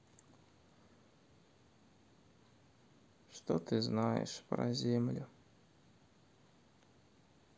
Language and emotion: Russian, sad